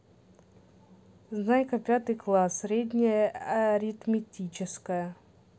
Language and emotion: Russian, neutral